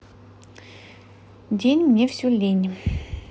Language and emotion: Russian, neutral